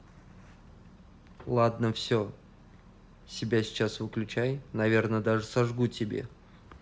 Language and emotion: Russian, neutral